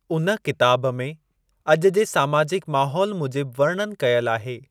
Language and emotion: Sindhi, neutral